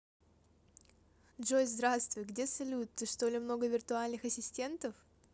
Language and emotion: Russian, positive